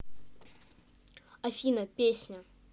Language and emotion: Russian, neutral